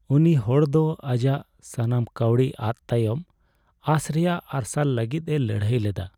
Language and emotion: Santali, sad